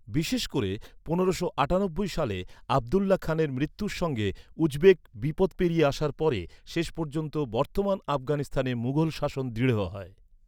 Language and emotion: Bengali, neutral